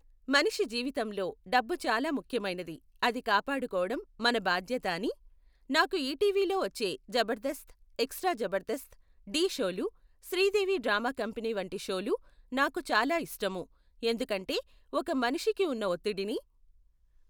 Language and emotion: Telugu, neutral